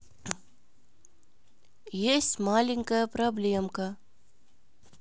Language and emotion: Russian, neutral